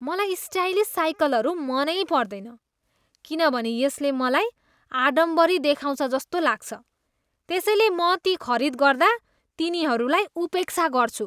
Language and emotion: Nepali, disgusted